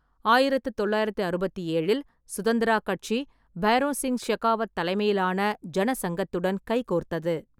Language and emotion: Tamil, neutral